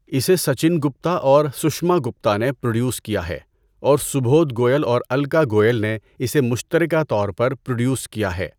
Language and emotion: Urdu, neutral